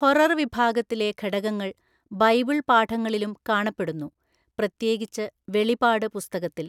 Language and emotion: Malayalam, neutral